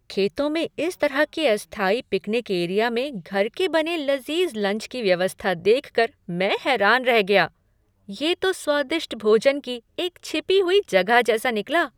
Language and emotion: Hindi, surprised